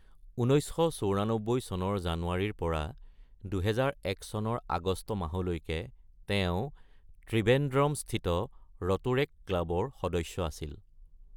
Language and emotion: Assamese, neutral